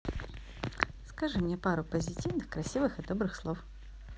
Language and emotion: Russian, positive